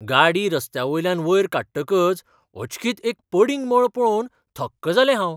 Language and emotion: Goan Konkani, surprised